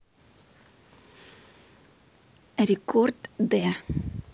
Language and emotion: Russian, neutral